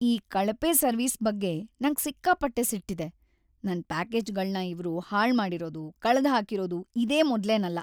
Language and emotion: Kannada, sad